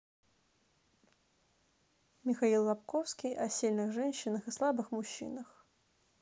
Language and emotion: Russian, neutral